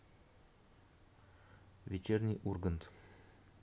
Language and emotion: Russian, neutral